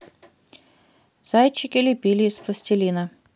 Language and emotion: Russian, neutral